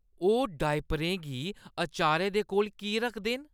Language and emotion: Dogri, disgusted